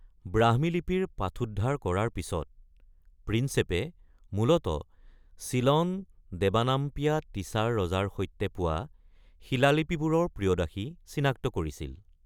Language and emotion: Assamese, neutral